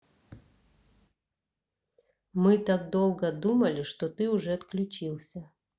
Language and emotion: Russian, neutral